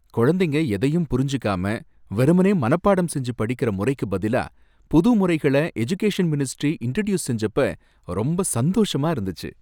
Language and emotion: Tamil, happy